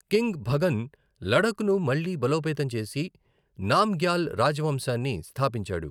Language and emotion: Telugu, neutral